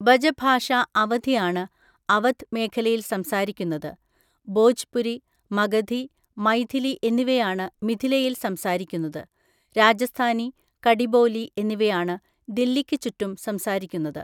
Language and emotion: Malayalam, neutral